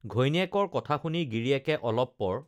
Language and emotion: Assamese, neutral